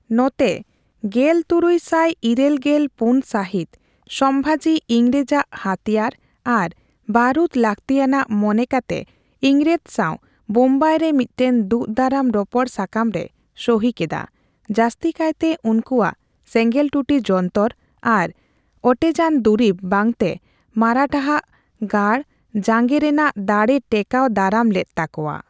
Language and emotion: Santali, neutral